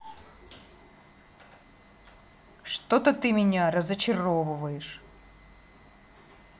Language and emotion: Russian, angry